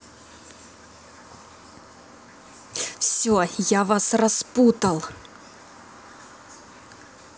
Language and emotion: Russian, angry